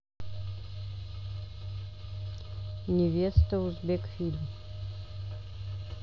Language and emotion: Russian, neutral